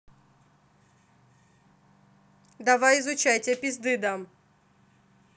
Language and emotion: Russian, angry